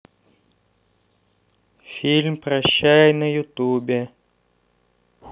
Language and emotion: Russian, neutral